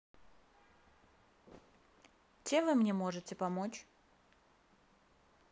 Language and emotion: Russian, neutral